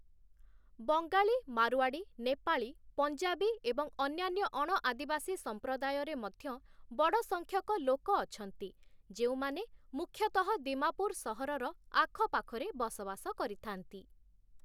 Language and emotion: Odia, neutral